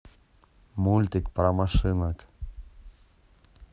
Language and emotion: Russian, neutral